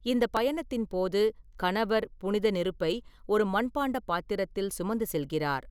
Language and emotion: Tamil, neutral